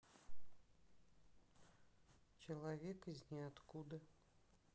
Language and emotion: Russian, neutral